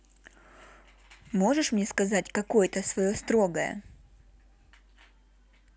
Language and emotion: Russian, neutral